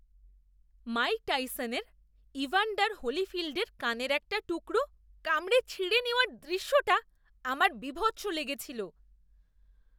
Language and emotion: Bengali, disgusted